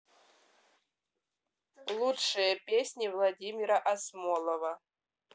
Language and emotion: Russian, neutral